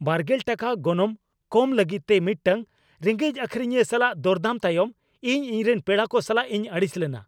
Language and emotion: Santali, angry